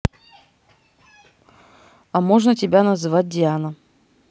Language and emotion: Russian, neutral